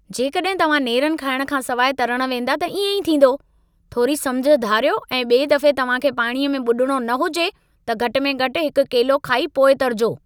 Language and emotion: Sindhi, angry